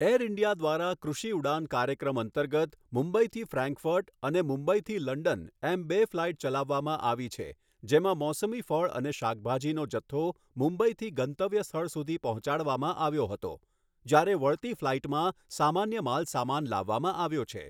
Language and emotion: Gujarati, neutral